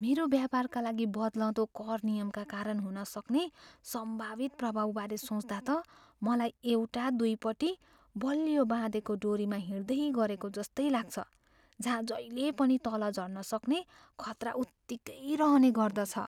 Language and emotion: Nepali, fearful